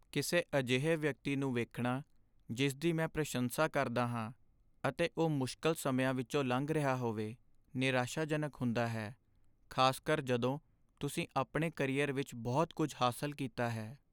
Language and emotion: Punjabi, sad